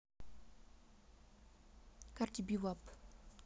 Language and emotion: Russian, neutral